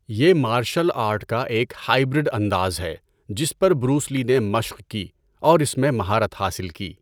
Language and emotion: Urdu, neutral